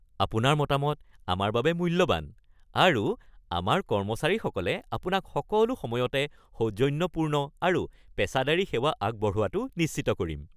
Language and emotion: Assamese, happy